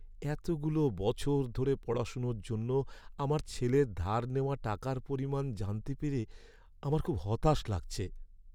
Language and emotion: Bengali, sad